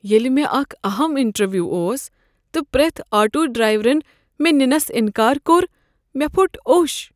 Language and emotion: Kashmiri, sad